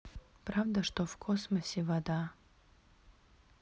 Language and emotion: Russian, neutral